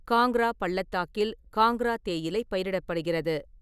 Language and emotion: Tamil, neutral